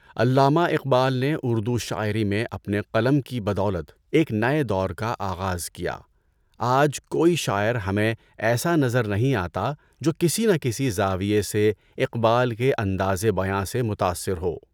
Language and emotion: Urdu, neutral